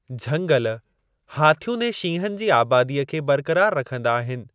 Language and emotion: Sindhi, neutral